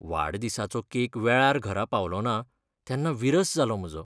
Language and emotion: Goan Konkani, sad